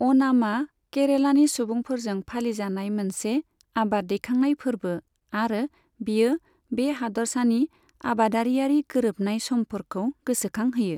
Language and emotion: Bodo, neutral